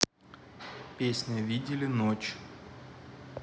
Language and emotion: Russian, neutral